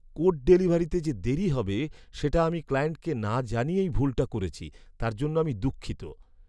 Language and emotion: Bengali, sad